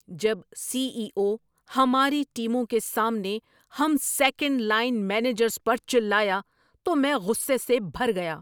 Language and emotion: Urdu, angry